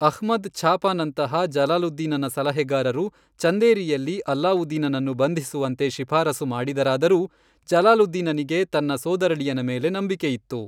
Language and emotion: Kannada, neutral